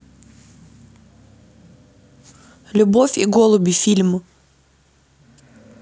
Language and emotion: Russian, neutral